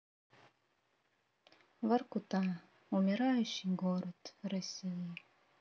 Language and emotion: Russian, sad